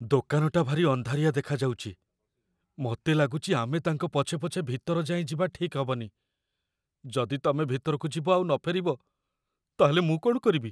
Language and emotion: Odia, fearful